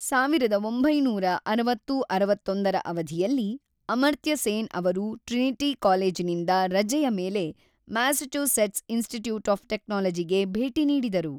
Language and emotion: Kannada, neutral